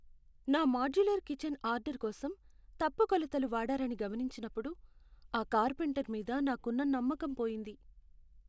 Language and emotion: Telugu, sad